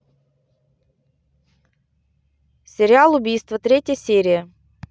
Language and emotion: Russian, neutral